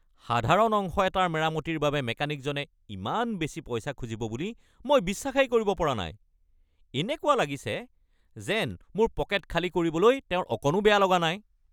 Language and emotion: Assamese, angry